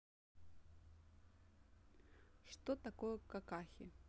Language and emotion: Russian, neutral